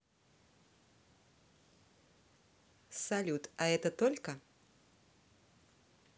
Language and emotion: Russian, positive